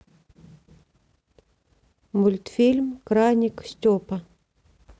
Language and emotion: Russian, neutral